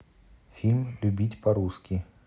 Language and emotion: Russian, neutral